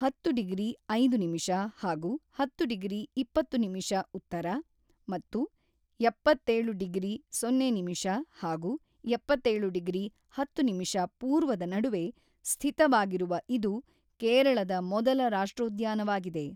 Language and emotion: Kannada, neutral